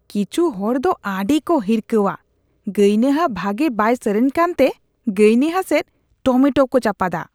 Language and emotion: Santali, disgusted